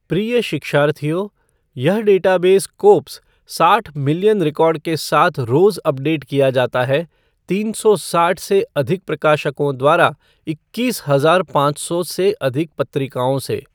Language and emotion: Hindi, neutral